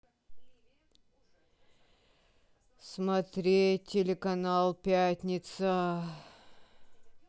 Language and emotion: Russian, sad